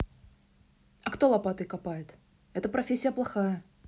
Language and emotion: Russian, neutral